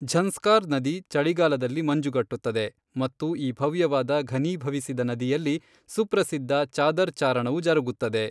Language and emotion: Kannada, neutral